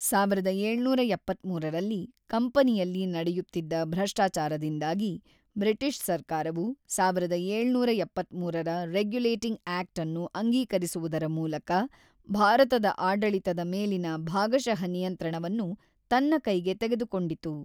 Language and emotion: Kannada, neutral